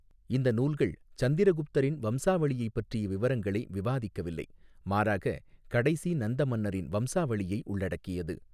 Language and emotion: Tamil, neutral